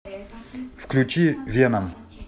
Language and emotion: Russian, neutral